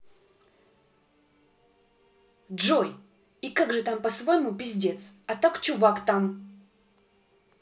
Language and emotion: Russian, angry